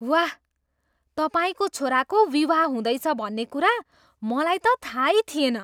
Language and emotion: Nepali, surprised